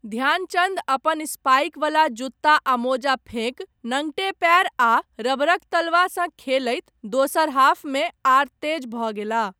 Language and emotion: Maithili, neutral